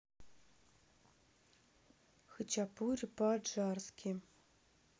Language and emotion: Russian, neutral